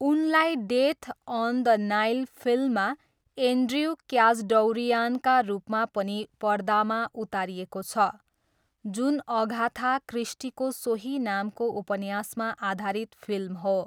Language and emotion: Nepali, neutral